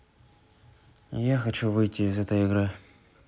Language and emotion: Russian, sad